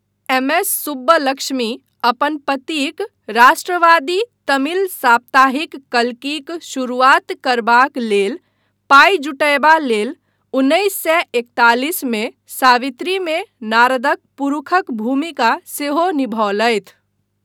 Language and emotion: Maithili, neutral